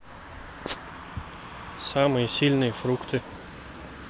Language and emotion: Russian, neutral